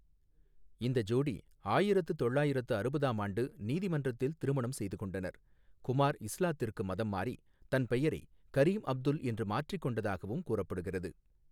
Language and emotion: Tamil, neutral